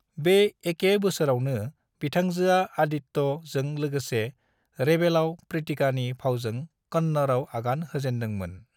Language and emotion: Bodo, neutral